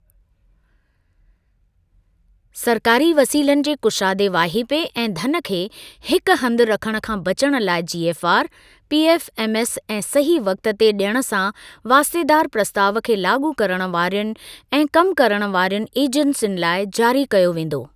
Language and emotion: Sindhi, neutral